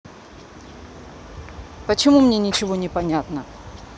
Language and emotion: Russian, angry